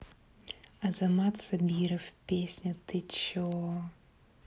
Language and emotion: Russian, neutral